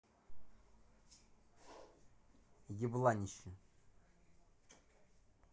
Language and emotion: Russian, neutral